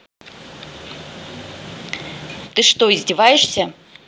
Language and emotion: Russian, angry